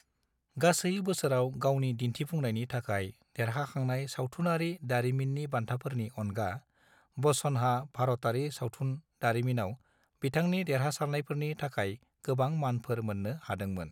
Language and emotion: Bodo, neutral